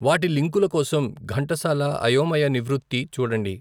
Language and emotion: Telugu, neutral